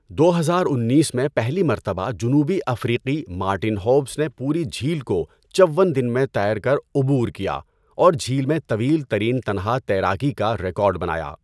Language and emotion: Urdu, neutral